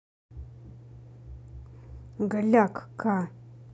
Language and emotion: Russian, angry